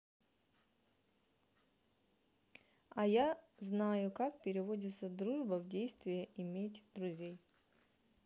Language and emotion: Russian, neutral